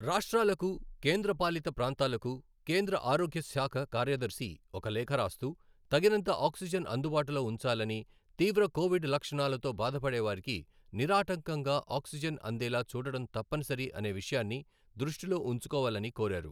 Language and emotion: Telugu, neutral